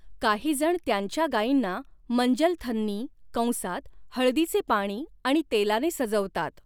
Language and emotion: Marathi, neutral